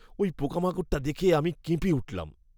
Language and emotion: Bengali, disgusted